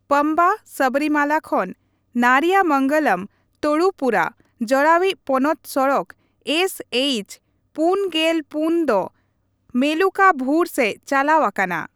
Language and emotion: Santali, neutral